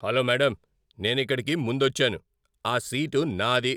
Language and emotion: Telugu, angry